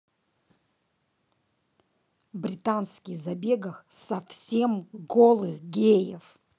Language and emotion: Russian, angry